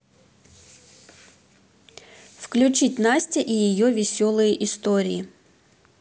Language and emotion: Russian, neutral